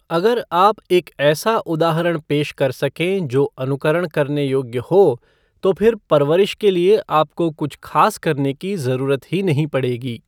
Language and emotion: Hindi, neutral